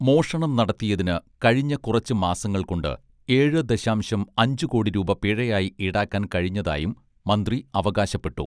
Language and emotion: Malayalam, neutral